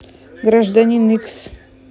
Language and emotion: Russian, neutral